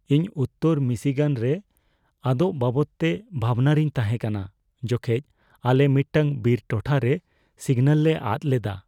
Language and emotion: Santali, fearful